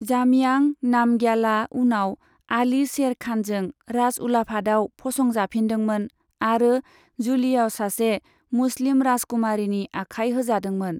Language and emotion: Bodo, neutral